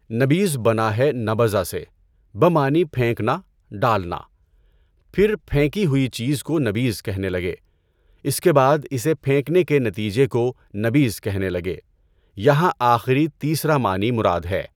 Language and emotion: Urdu, neutral